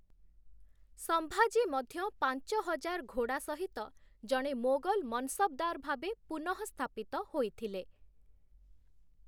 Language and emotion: Odia, neutral